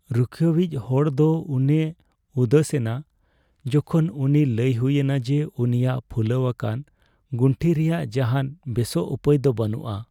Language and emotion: Santali, sad